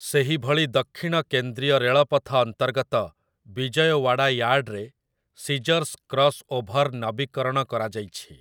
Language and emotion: Odia, neutral